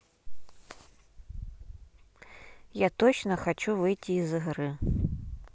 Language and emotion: Russian, neutral